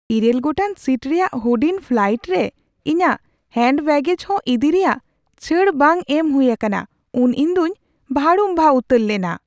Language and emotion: Santali, surprised